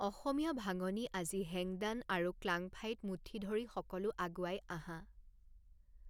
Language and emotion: Assamese, neutral